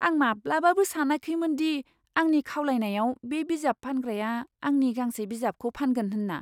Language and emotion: Bodo, surprised